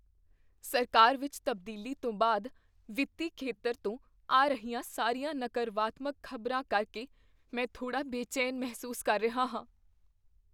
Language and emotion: Punjabi, fearful